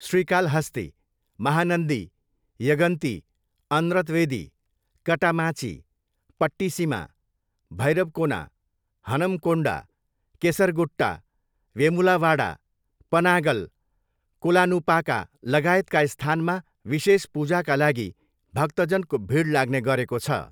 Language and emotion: Nepali, neutral